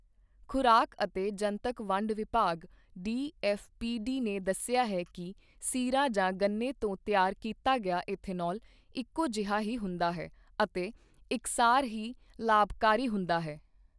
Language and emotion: Punjabi, neutral